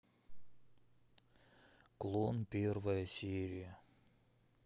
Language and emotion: Russian, sad